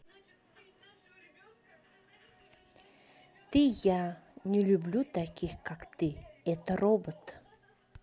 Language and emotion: Russian, neutral